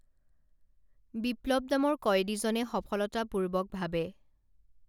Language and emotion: Assamese, neutral